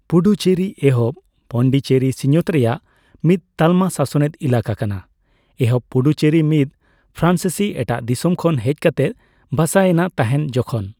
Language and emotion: Santali, neutral